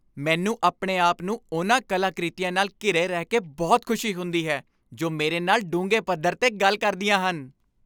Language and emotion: Punjabi, happy